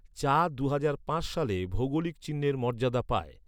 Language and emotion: Bengali, neutral